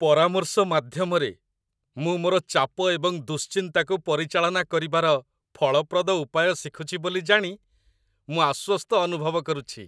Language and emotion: Odia, happy